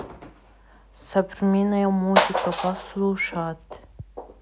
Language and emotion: Russian, neutral